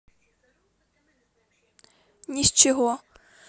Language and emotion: Russian, neutral